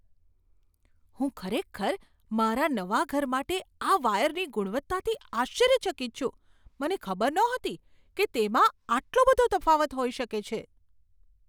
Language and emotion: Gujarati, surprised